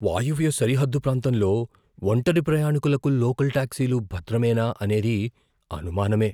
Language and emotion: Telugu, fearful